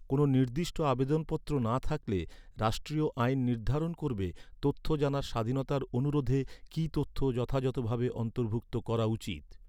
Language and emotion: Bengali, neutral